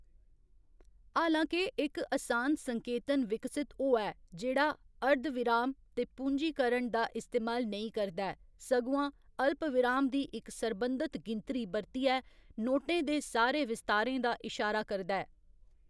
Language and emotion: Dogri, neutral